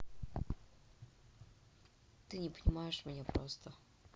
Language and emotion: Russian, sad